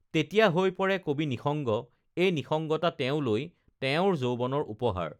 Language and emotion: Assamese, neutral